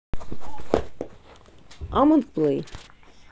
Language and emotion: Russian, neutral